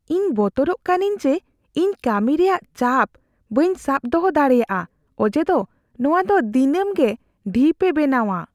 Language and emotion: Santali, fearful